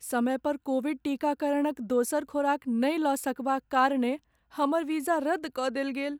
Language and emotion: Maithili, sad